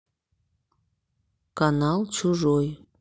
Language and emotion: Russian, neutral